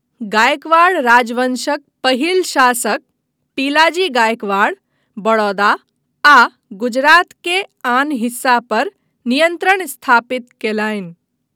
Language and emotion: Maithili, neutral